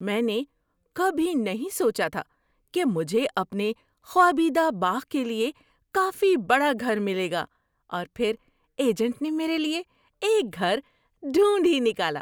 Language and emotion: Urdu, surprised